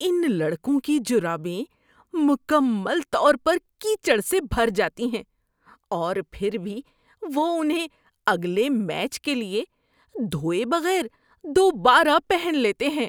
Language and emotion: Urdu, disgusted